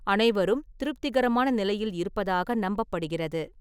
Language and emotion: Tamil, neutral